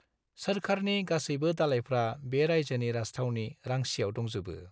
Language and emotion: Bodo, neutral